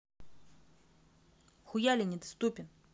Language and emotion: Russian, angry